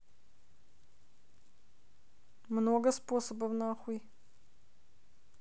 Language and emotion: Russian, neutral